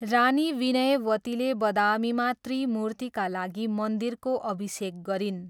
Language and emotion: Nepali, neutral